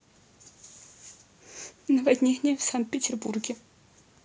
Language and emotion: Russian, sad